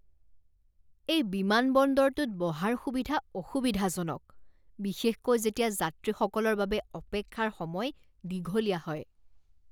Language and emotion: Assamese, disgusted